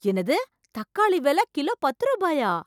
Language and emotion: Tamil, surprised